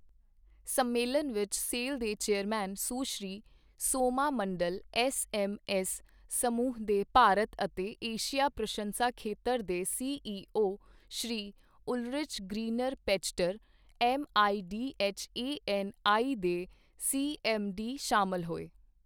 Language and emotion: Punjabi, neutral